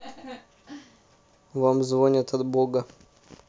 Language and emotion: Russian, neutral